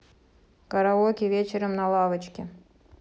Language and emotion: Russian, neutral